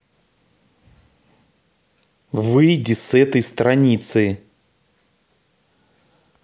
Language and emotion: Russian, angry